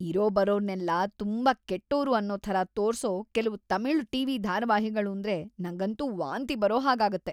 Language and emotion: Kannada, disgusted